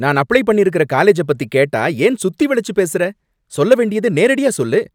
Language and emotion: Tamil, angry